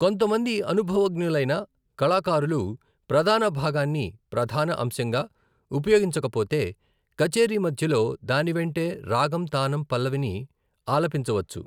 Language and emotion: Telugu, neutral